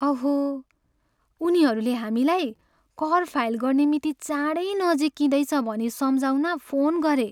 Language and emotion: Nepali, sad